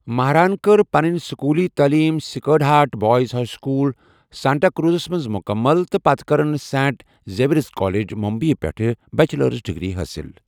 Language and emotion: Kashmiri, neutral